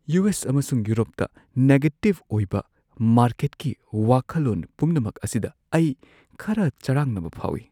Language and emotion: Manipuri, fearful